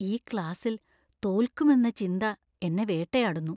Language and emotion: Malayalam, fearful